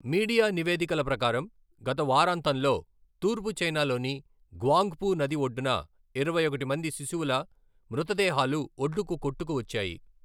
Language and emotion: Telugu, neutral